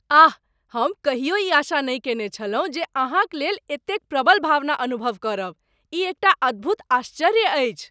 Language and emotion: Maithili, surprised